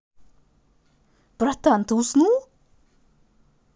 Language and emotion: Russian, positive